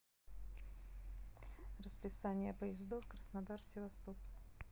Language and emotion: Russian, neutral